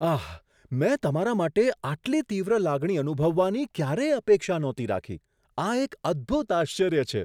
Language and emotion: Gujarati, surprised